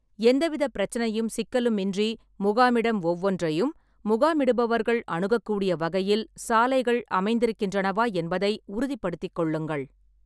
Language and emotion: Tamil, neutral